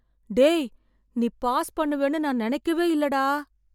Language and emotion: Tamil, surprised